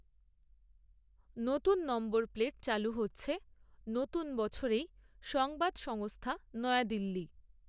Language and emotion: Bengali, neutral